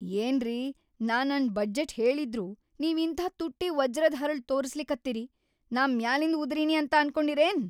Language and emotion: Kannada, angry